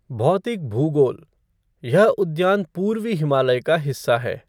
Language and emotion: Hindi, neutral